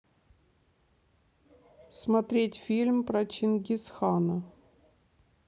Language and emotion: Russian, neutral